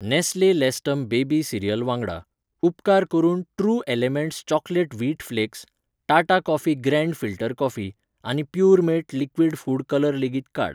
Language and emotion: Goan Konkani, neutral